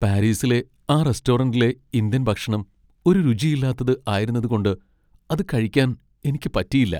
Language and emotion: Malayalam, sad